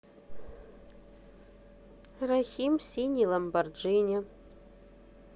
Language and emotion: Russian, neutral